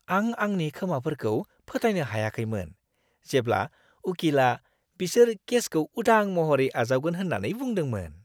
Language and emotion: Bodo, surprised